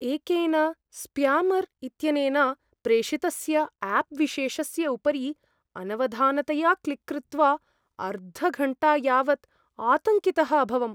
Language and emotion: Sanskrit, fearful